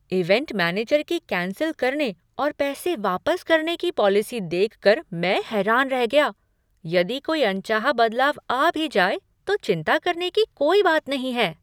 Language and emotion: Hindi, surprised